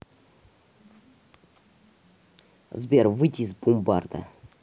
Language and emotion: Russian, neutral